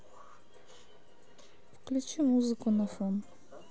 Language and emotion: Russian, sad